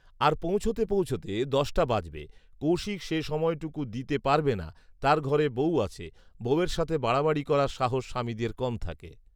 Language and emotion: Bengali, neutral